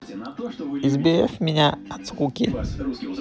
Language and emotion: Russian, neutral